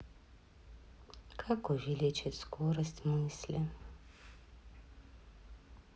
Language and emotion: Russian, sad